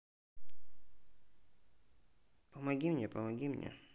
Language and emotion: Russian, neutral